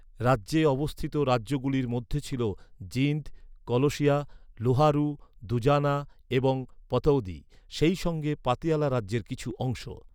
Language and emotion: Bengali, neutral